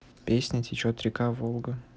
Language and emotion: Russian, neutral